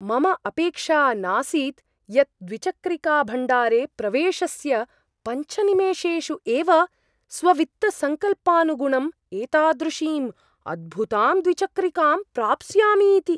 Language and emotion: Sanskrit, surprised